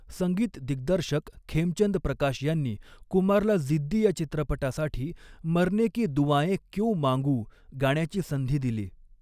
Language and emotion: Marathi, neutral